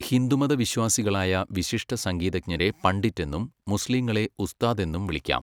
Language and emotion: Malayalam, neutral